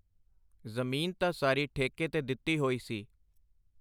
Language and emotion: Punjabi, neutral